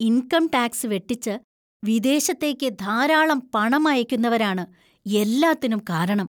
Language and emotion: Malayalam, disgusted